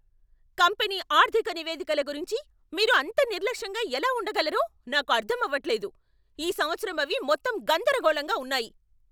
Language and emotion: Telugu, angry